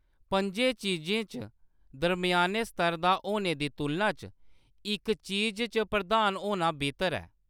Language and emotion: Dogri, neutral